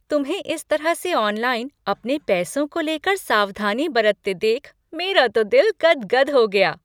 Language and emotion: Hindi, happy